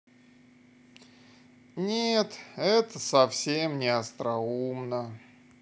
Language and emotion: Russian, sad